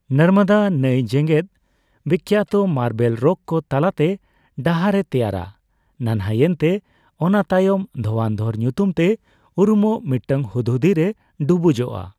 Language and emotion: Santali, neutral